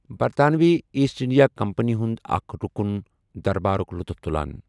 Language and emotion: Kashmiri, neutral